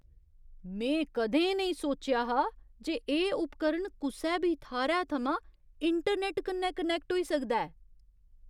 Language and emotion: Dogri, surprised